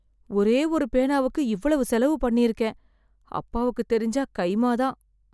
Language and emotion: Tamil, fearful